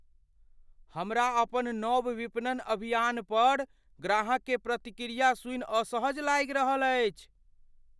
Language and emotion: Maithili, fearful